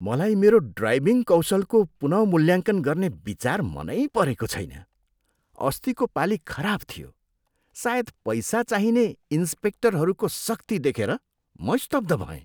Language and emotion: Nepali, disgusted